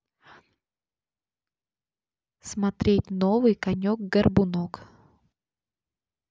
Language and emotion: Russian, neutral